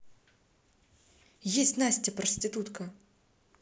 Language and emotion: Russian, angry